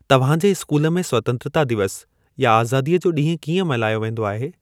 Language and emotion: Sindhi, neutral